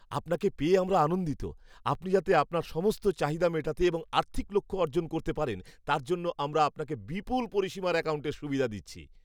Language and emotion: Bengali, happy